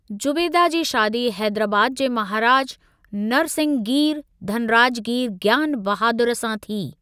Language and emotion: Sindhi, neutral